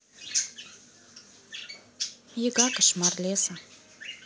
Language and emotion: Russian, neutral